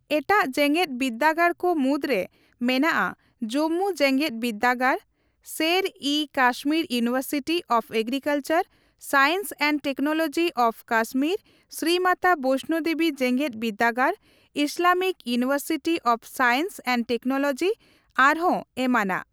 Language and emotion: Santali, neutral